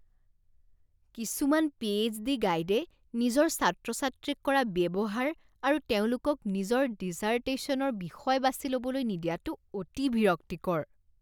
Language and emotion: Assamese, disgusted